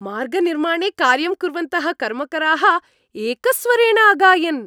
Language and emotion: Sanskrit, happy